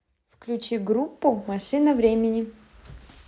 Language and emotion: Russian, positive